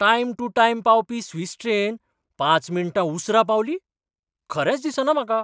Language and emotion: Goan Konkani, surprised